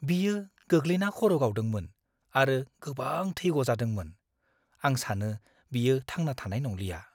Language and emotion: Bodo, fearful